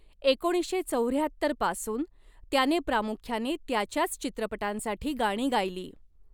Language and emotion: Marathi, neutral